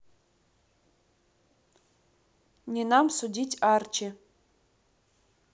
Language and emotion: Russian, neutral